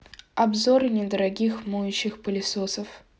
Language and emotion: Russian, neutral